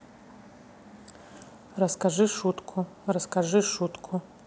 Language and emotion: Russian, neutral